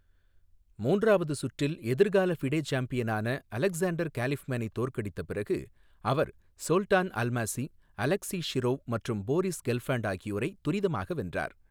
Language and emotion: Tamil, neutral